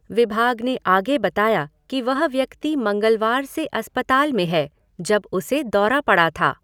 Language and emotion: Hindi, neutral